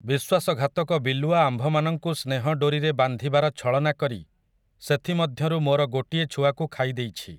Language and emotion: Odia, neutral